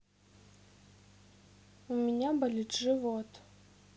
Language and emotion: Russian, sad